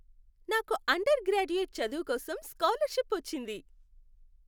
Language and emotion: Telugu, happy